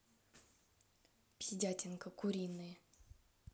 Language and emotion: Russian, angry